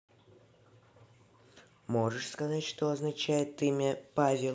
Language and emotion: Russian, neutral